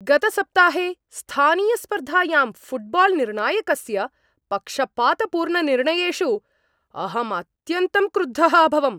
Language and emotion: Sanskrit, angry